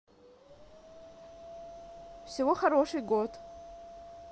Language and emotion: Russian, neutral